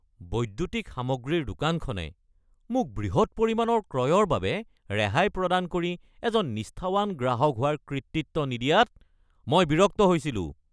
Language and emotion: Assamese, angry